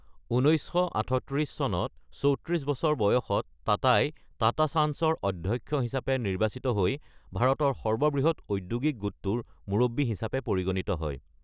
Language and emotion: Assamese, neutral